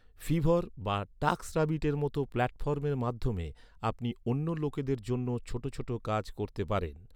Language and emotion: Bengali, neutral